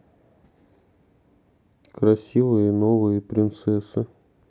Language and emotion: Russian, sad